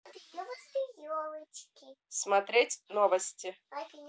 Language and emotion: Russian, neutral